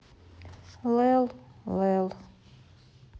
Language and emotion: Russian, sad